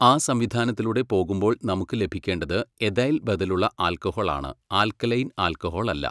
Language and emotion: Malayalam, neutral